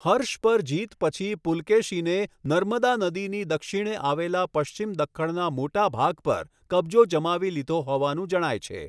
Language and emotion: Gujarati, neutral